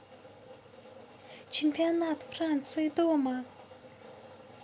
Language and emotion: Russian, positive